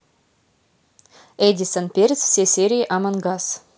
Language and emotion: Russian, neutral